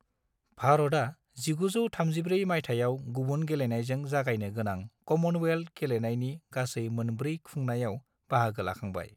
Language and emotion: Bodo, neutral